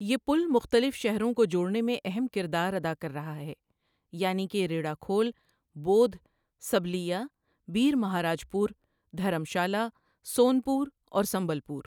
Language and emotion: Urdu, neutral